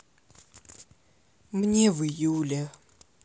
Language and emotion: Russian, sad